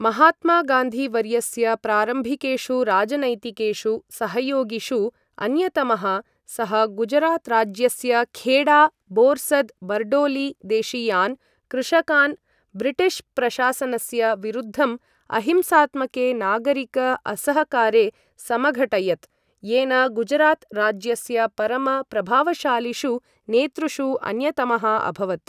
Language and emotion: Sanskrit, neutral